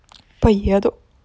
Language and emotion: Russian, neutral